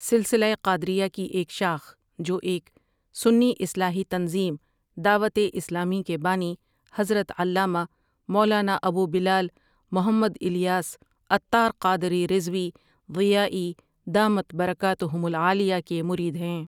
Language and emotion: Urdu, neutral